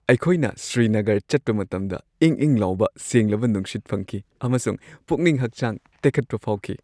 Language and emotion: Manipuri, happy